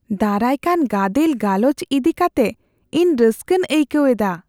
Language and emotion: Santali, fearful